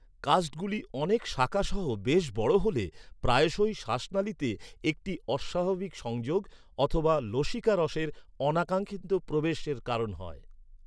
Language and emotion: Bengali, neutral